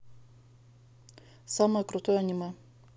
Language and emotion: Russian, neutral